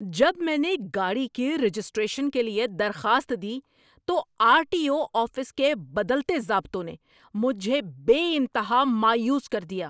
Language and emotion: Urdu, angry